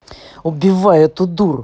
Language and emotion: Russian, angry